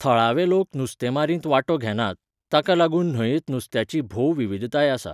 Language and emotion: Goan Konkani, neutral